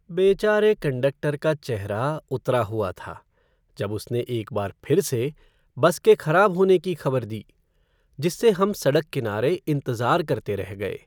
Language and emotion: Hindi, sad